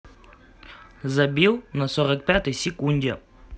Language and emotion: Russian, neutral